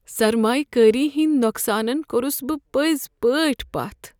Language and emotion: Kashmiri, sad